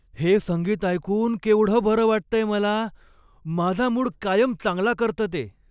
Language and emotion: Marathi, happy